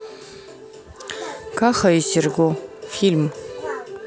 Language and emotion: Russian, neutral